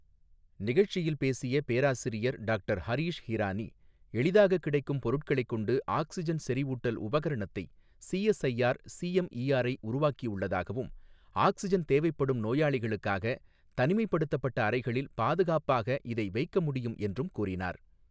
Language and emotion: Tamil, neutral